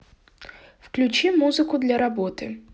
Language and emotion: Russian, neutral